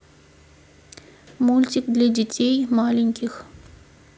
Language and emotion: Russian, neutral